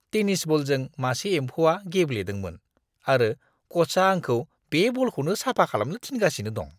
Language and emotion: Bodo, disgusted